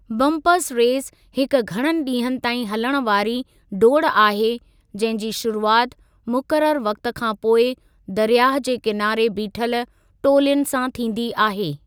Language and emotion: Sindhi, neutral